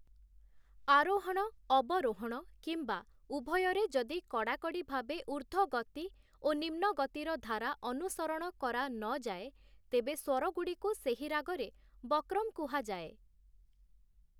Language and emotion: Odia, neutral